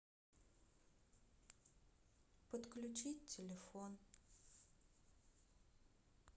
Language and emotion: Russian, sad